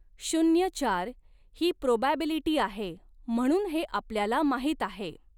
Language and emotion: Marathi, neutral